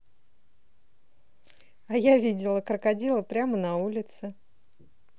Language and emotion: Russian, positive